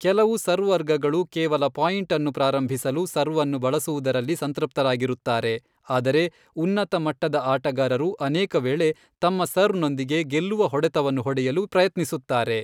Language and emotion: Kannada, neutral